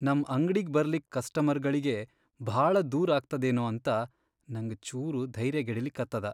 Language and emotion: Kannada, sad